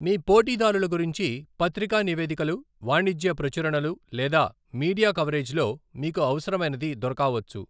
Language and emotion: Telugu, neutral